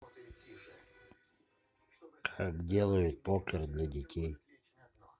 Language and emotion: Russian, neutral